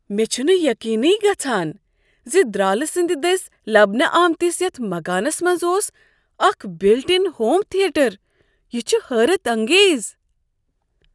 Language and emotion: Kashmiri, surprised